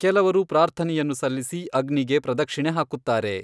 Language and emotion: Kannada, neutral